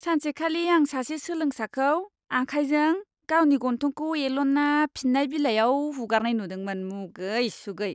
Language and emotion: Bodo, disgusted